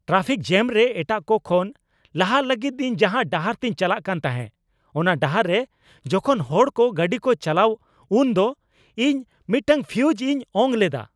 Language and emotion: Santali, angry